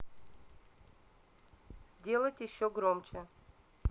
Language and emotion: Russian, neutral